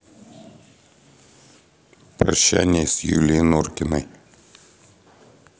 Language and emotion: Russian, sad